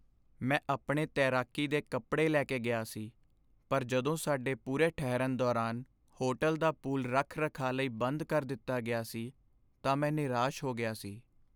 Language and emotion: Punjabi, sad